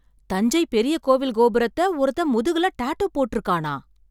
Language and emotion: Tamil, surprised